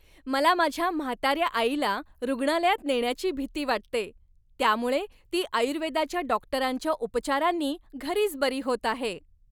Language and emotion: Marathi, happy